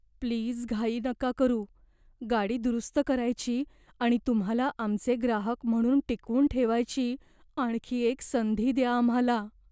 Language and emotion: Marathi, fearful